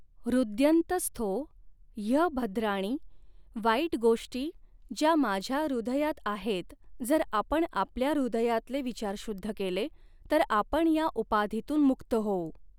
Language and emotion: Marathi, neutral